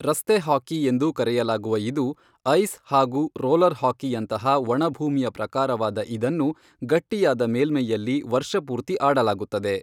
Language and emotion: Kannada, neutral